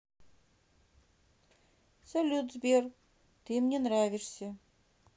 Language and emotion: Russian, neutral